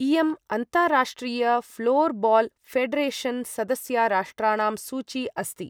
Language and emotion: Sanskrit, neutral